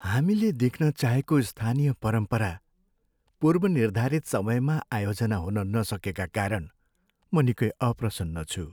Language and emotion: Nepali, sad